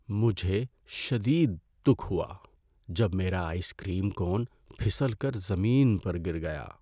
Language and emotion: Urdu, sad